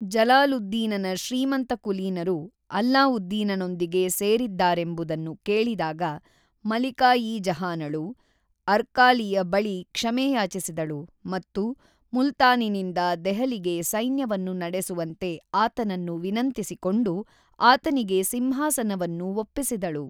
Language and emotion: Kannada, neutral